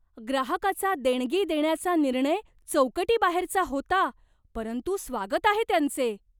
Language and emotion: Marathi, surprised